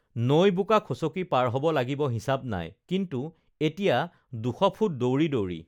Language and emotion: Assamese, neutral